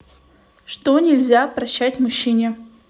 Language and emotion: Russian, neutral